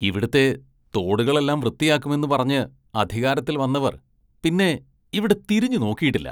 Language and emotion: Malayalam, disgusted